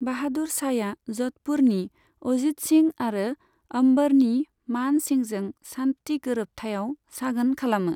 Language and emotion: Bodo, neutral